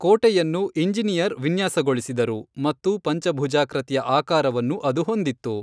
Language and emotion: Kannada, neutral